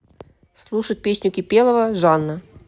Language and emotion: Russian, neutral